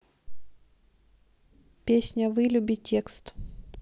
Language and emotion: Russian, neutral